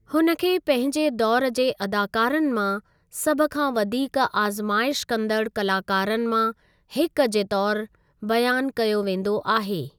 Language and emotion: Sindhi, neutral